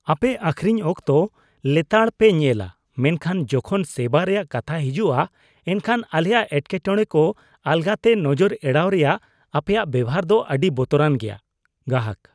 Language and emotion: Santali, disgusted